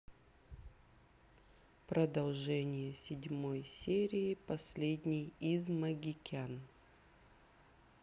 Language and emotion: Russian, neutral